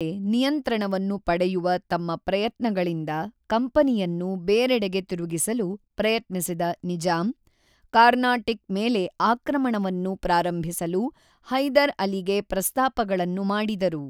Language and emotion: Kannada, neutral